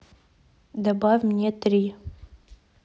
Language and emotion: Russian, neutral